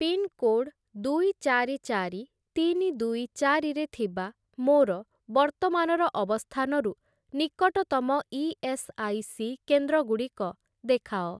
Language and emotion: Odia, neutral